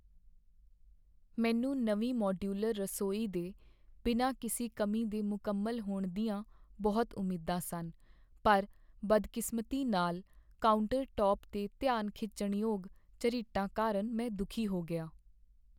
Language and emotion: Punjabi, sad